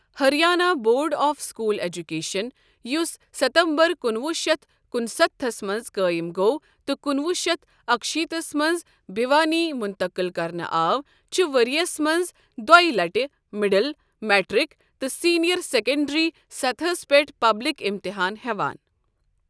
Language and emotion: Kashmiri, neutral